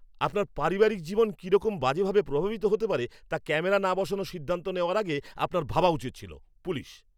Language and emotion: Bengali, angry